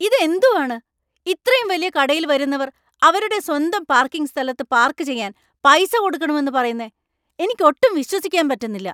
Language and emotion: Malayalam, angry